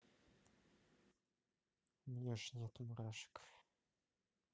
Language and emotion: Russian, neutral